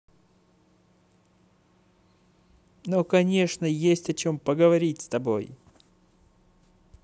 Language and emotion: Russian, positive